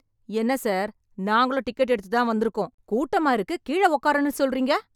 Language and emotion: Tamil, angry